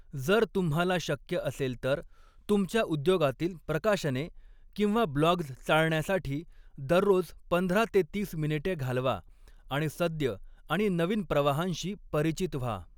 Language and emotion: Marathi, neutral